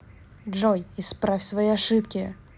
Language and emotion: Russian, angry